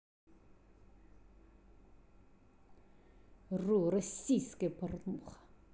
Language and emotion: Russian, angry